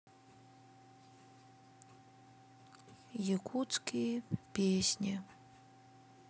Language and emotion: Russian, sad